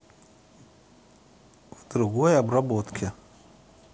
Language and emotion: Russian, neutral